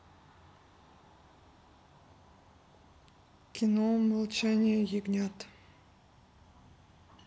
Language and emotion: Russian, neutral